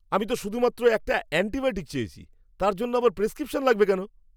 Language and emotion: Bengali, angry